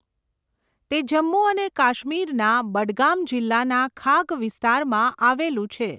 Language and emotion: Gujarati, neutral